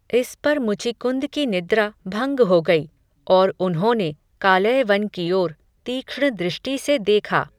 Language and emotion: Hindi, neutral